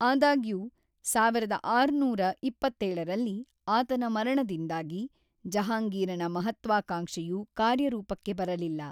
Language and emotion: Kannada, neutral